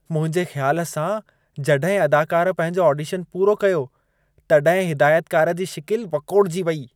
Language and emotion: Sindhi, disgusted